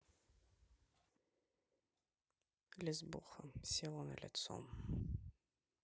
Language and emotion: Russian, neutral